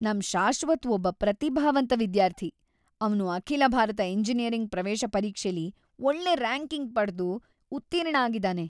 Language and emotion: Kannada, happy